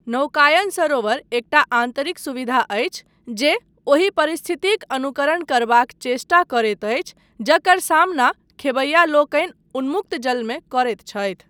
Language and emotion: Maithili, neutral